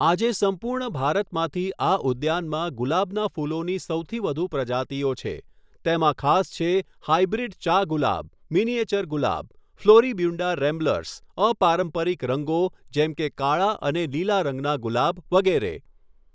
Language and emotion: Gujarati, neutral